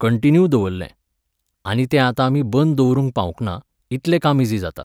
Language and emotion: Goan Konkani, neutral